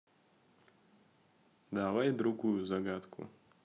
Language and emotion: Russian, neutral